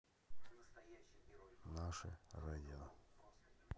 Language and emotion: Russian, neutral